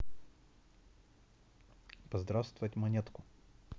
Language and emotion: Russian, neutral